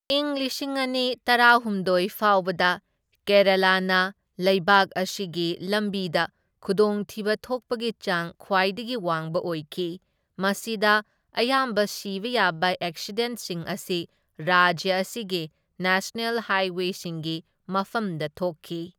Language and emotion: Manipuri, neutral